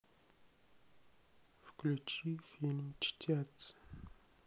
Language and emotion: Russian, sad